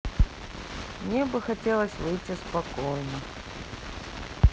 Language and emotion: Russian, sad